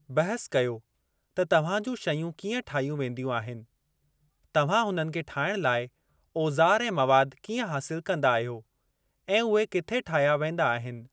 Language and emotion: Sindhi, neutral